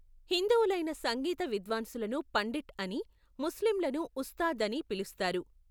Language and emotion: Telugu, neutral